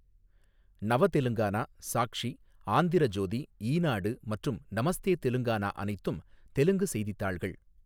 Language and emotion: Tamil, neutral